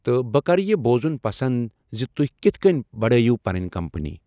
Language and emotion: Kashmiri, neutral